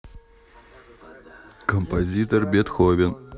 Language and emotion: Russian, neutral